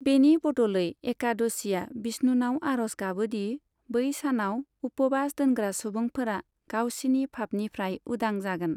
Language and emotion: Bodo, neutral